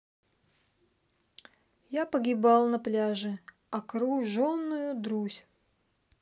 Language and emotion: Russian, sad